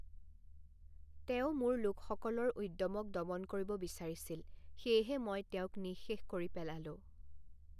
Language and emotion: Assamese, neutral